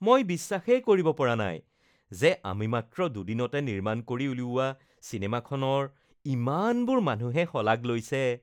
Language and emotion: Assamese, happy